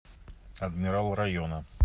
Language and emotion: Russian, neutral